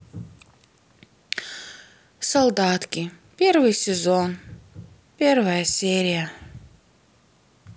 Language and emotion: Russian, sad